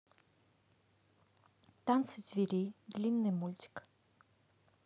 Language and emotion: Russian, neutral